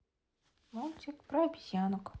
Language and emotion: Russian, neutral